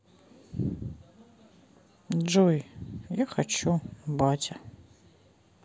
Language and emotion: Russian, sad